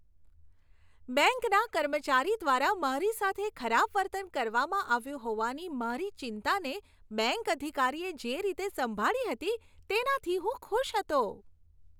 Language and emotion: Gujarati, happy